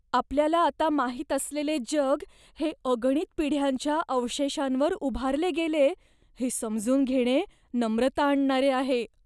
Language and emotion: Marathi, fearful